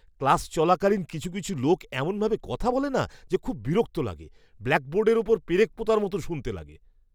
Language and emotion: Bengali, disgusted